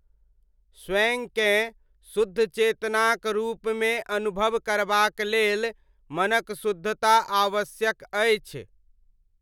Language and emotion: Maithili, neutral